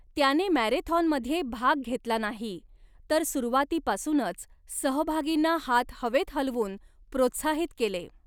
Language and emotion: Marathi, neutral